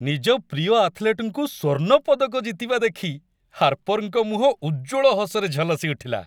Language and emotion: Odia, happy